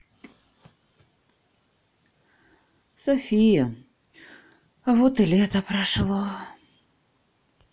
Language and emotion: Russian, sad